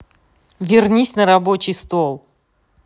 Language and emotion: Russian, angry